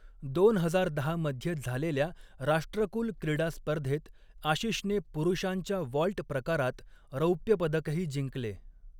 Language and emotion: Marathi, neutral